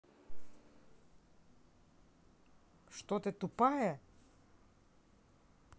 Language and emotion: Russian, angry